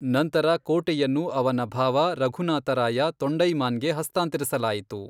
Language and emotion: Kannada, neutral